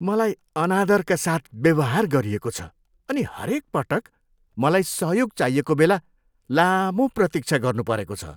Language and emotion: Nepali, disgusted